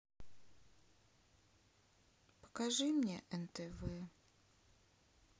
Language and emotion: Russian, sad